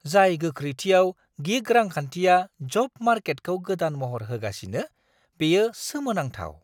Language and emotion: Bodo, surprised